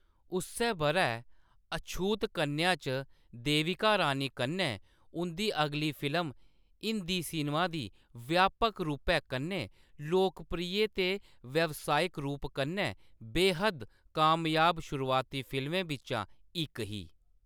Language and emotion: Dogri, neutral